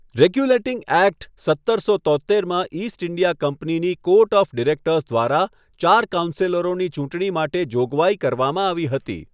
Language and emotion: Gujarati, neutral